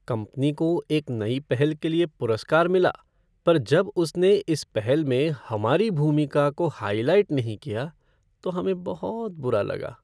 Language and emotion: Hindi, sad